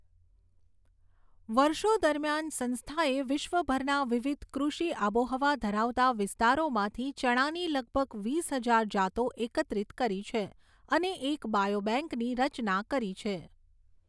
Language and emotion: Gujarati, neutral